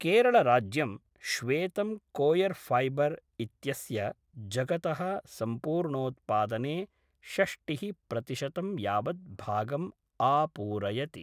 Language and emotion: Sanskrit, neutral